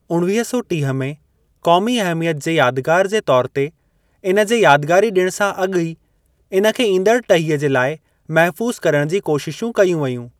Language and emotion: Sindhi, neutral